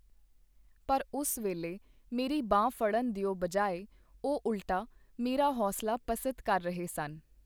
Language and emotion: Punjabi, neutral